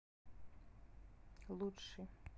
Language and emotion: Russian, neutral